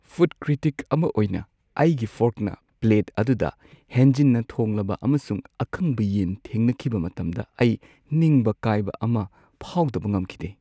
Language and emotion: Manipuri, sad